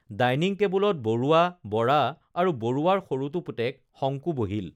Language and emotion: Assamese, neutral